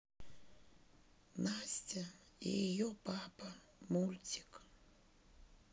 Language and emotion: Russian, sad